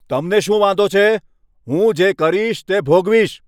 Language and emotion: Gujarati, angry